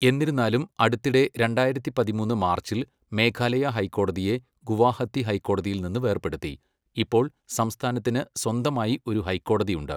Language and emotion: Malayalam, neutral